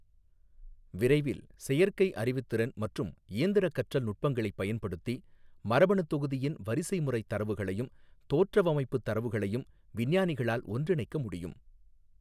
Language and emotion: Tamil, neutral